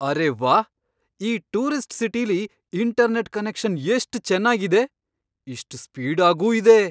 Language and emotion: Kannada, surprised